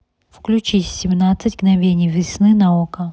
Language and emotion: Russian, neutral